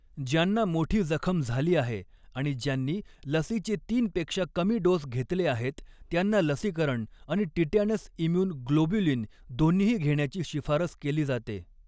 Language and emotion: Marathi, neutral